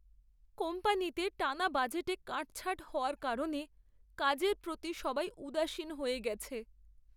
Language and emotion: Bengali, sad